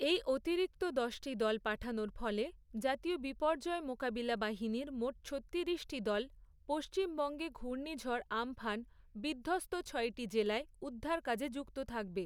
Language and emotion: Bengali, neutral